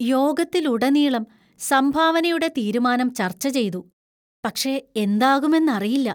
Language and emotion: Malayalam, fearful